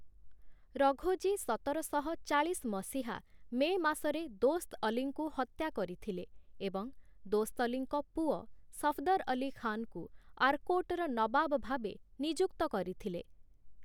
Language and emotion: Odia, neutral